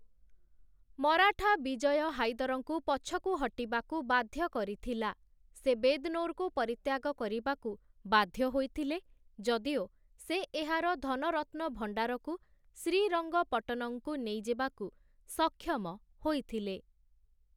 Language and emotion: Odia, neutral